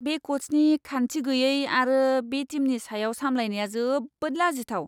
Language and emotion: Bodo, disgusted